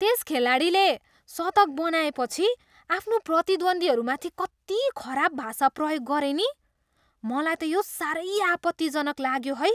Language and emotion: Nepali, disgusted